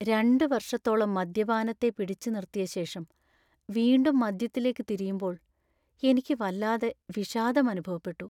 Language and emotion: Malayalam, sad